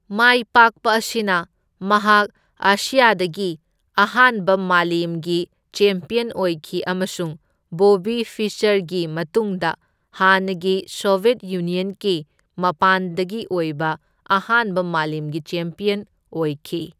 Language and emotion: Manipuri, neutral